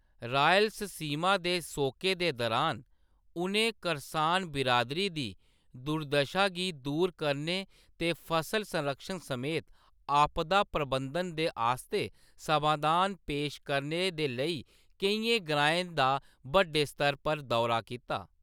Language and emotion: Dogri, neutral